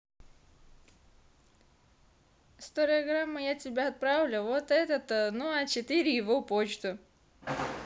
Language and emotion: Russian, positive